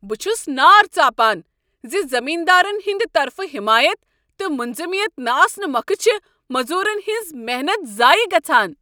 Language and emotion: Kashmiri, angry